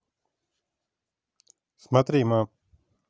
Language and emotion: Russian, neutral